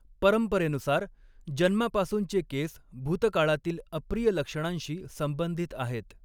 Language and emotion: Marathi, neutral